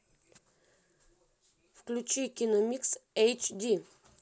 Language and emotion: Russian, neutral